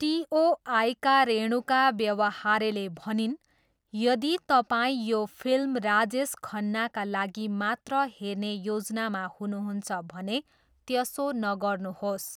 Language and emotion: Nepali, neutral